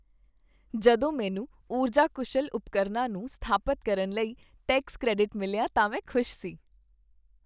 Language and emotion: Punjabi, happy